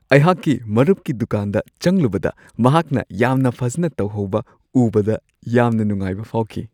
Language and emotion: Manipuri, happy